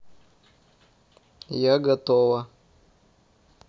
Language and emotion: Russian, neutral